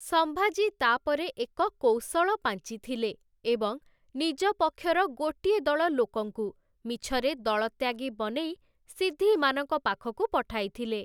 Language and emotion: Odia, neutral